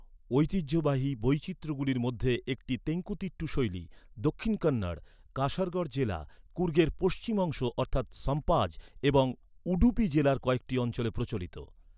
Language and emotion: Bengali, neutral